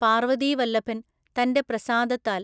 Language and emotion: Malayalam, neutral